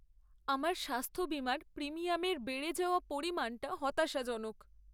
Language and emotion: Bengali, sad